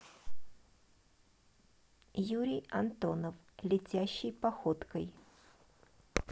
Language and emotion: Russian, neutral